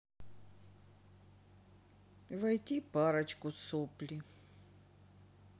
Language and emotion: Russian, sad